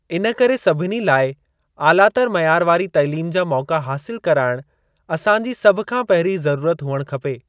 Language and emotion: Sindhi, neutral